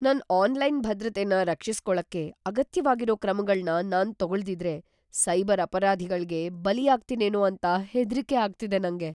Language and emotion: Kannada, fearful